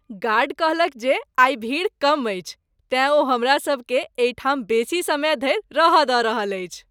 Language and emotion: Maithili, happy